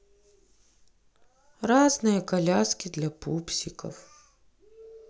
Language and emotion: Russian, sad